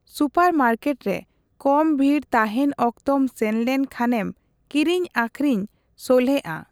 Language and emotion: Santali, neutral